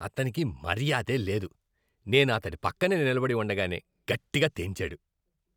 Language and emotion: Telugu, disgusted